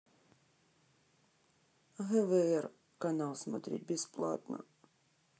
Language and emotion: Russian, sad